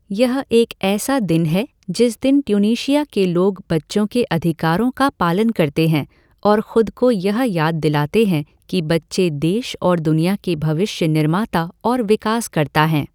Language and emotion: Hindi, neutral